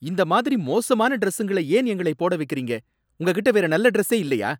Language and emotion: Tamil, angry